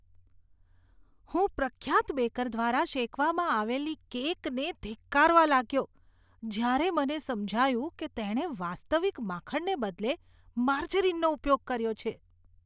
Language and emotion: Gujarati, disgusted